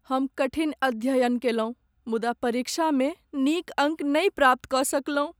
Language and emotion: Maithili, sad